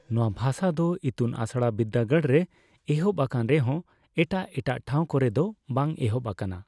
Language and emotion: Santali, neutral